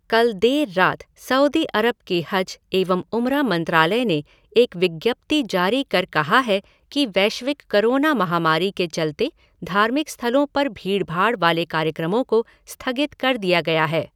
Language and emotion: Hindi, neutral